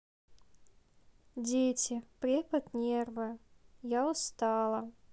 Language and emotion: Russian, sad